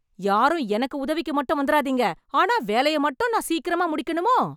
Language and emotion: Tamil, angry